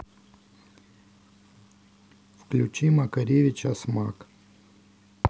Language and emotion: Russian, neutral